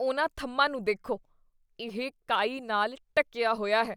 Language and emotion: Punjabi, disgusted